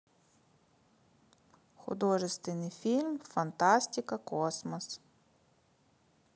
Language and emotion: Russian, neutral